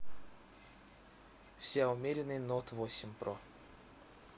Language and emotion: Russian, neutral